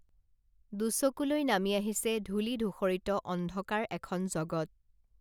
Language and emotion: Assamese, neutral